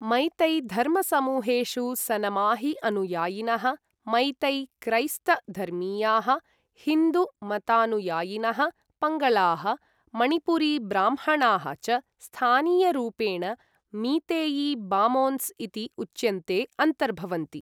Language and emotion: Sanskrit, neutral